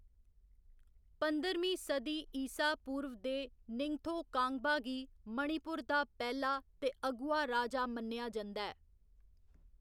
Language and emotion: Dogri, neutral